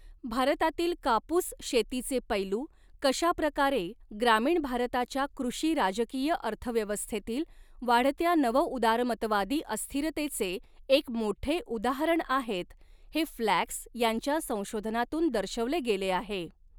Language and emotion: Marathi, neutral